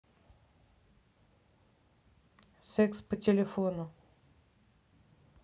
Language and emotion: Russian, neutral